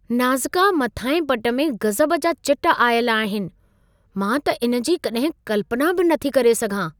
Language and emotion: Sindhi, surprised